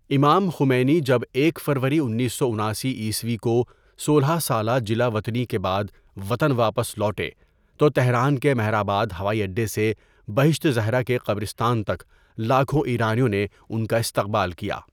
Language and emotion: Urdu, neutral